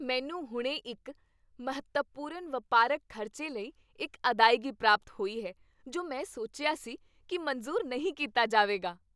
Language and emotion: Punjabi, happy